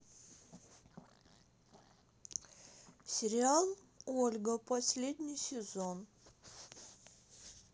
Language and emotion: Russian, neutral